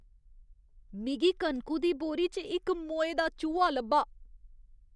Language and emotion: Dogri, disgusted